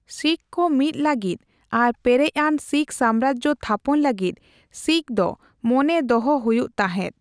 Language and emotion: Santali, neutral